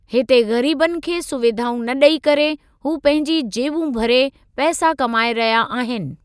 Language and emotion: Sindhi, neutral